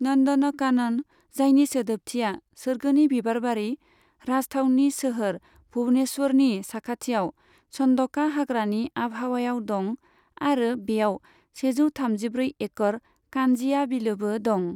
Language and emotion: Bodo, neutral